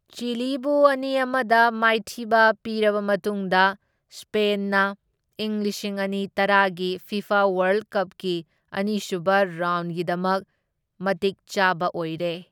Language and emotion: Manipuri, neutral